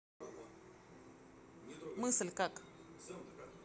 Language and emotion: Russian, neutral